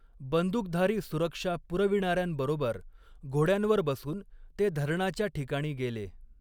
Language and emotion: Marathi, neutral